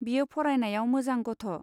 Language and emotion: Bodo, neutral